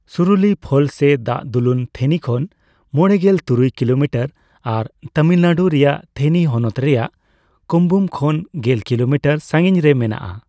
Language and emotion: Santali, neutral